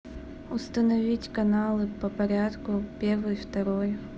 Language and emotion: Russian, neutral